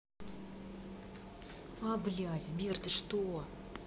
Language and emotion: Russian, angry